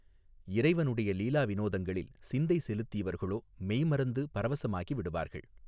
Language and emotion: Tamil, neutral